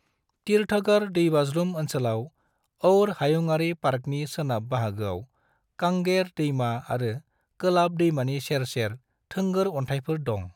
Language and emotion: Bodo, neutral